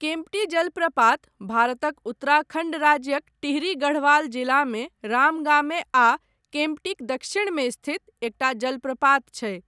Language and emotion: Maithili, neutral